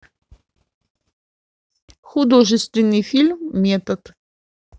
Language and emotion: Russian, neutral